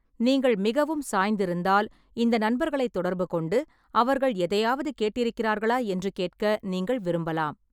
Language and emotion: Tamil, neutral